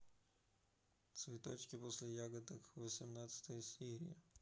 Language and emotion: Russian, neutral